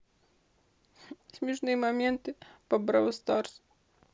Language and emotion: Russian, sad